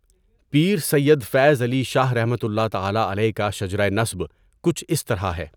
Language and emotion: Urdu, neutral